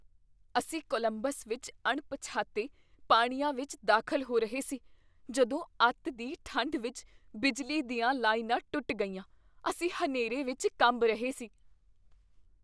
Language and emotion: Punjabi, fearful